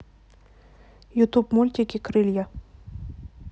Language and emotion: Russian, neutral